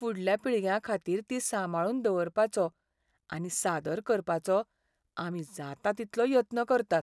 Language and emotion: Goan Konkani, sad